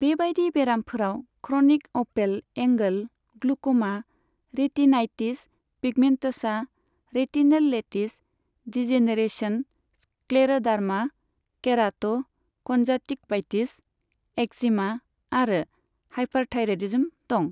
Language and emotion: Bodo, neutral